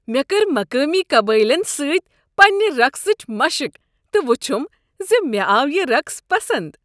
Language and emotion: Kashmiri, happy